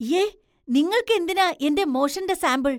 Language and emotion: Malayalam, disgusted